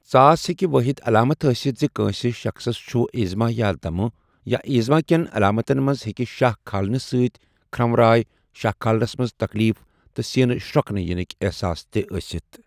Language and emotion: Kashmiri, neutral